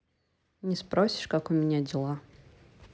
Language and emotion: Russian, neutral